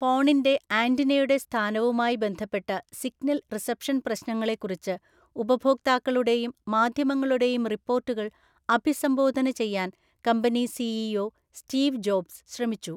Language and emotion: Malayalam, neutral